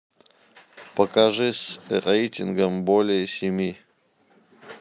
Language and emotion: Russian, neutral